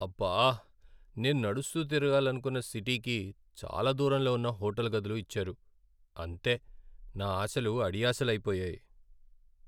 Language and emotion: Telugu, sad